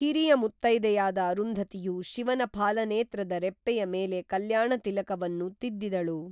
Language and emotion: Kannada, neutral